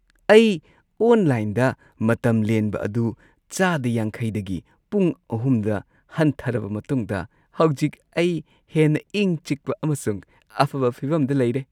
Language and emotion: Manipuri, happy